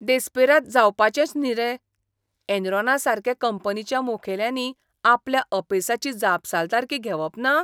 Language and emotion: Goan Konkani, disgusted